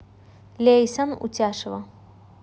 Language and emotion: Russian, neutral